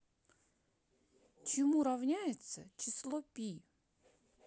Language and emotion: Russian, neutral